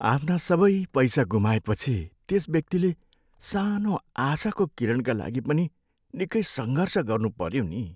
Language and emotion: Nepali, sad